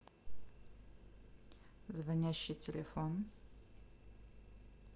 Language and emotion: Russian, neutral